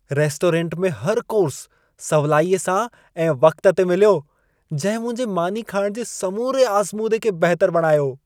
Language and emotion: Sindhi, happy